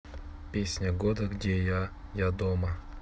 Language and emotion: Russian, neutral